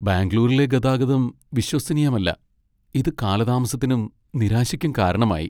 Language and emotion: Malayalam, sad